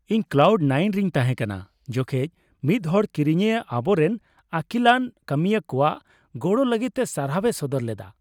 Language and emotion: Santali, happy